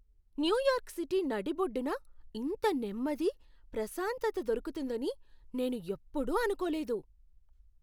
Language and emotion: Telugu, surprised